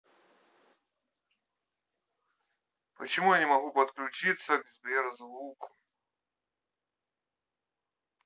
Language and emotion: Russian, neutral